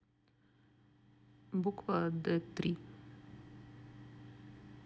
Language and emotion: Russian, neutral